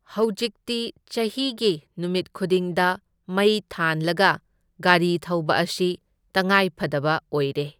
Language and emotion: Manipuri, neutral